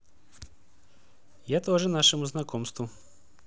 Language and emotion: Russian, positive